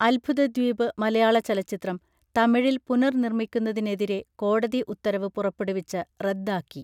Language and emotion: Malayalam, neutral